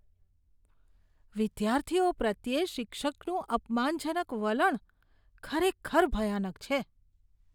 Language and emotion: Gujarati, disgusted